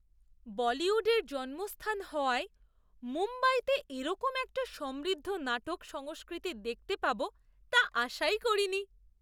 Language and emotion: Bengali, surprised